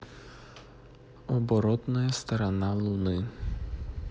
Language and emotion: Russian, neutral